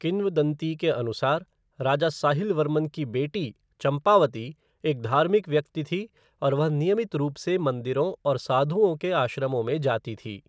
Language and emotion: Hindi, neutral